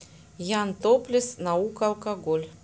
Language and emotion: Russian, neutral